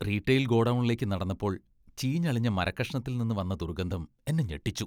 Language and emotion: Malayalam, disgusted